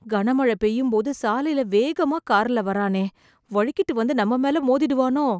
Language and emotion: Tamil, fearful